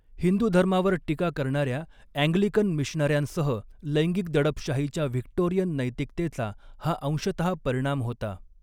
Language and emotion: Marathi, neutral